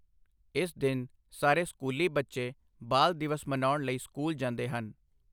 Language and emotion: Punjabi, neutral